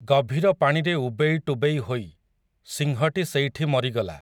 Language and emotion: Odia, neutral